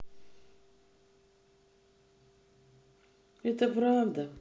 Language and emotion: Russian, sad